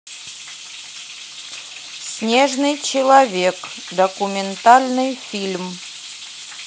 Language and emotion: Russian, neutral